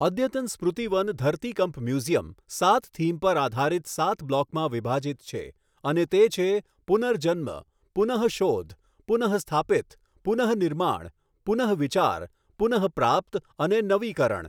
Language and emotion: Gujarati, neutral